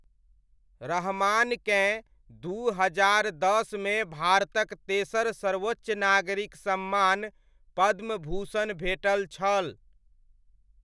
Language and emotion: Maithili, neutral